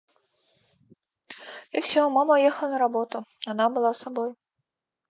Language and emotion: Russian, neutral